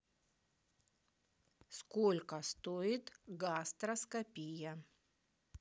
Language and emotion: Russian, neutral